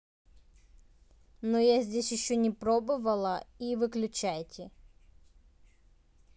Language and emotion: Russian, neutral